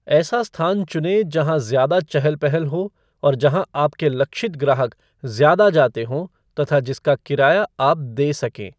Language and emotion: Hindi, neutral